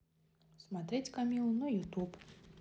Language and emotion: Russian, neutral